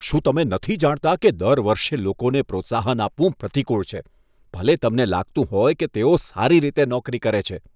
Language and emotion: Gujarati, disgusted